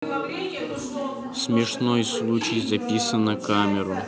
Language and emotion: Russian, neutral